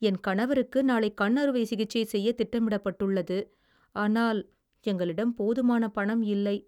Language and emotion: Tamil, sad